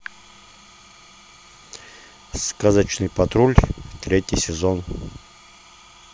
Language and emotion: Russian, neutral